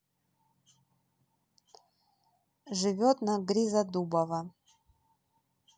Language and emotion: Russian, neutral